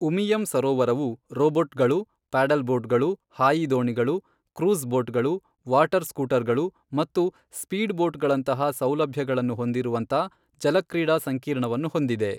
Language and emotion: Kannada, neutral